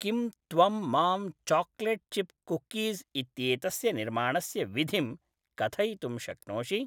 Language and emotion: Sanskrit, neutral